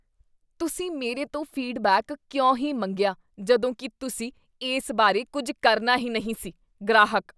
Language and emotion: Punjabi, disgusted